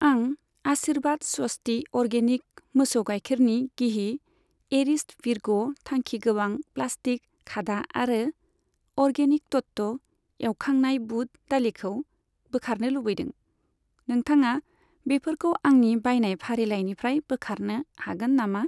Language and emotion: Bodo, neutral